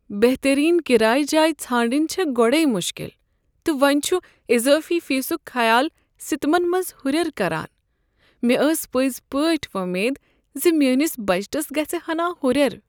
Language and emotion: Kashmiri, sad